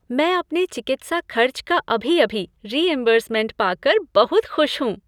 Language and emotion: Hindi, happy